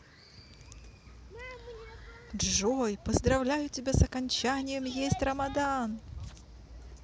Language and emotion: Russian, positive